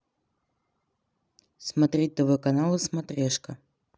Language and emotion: Russian, neutral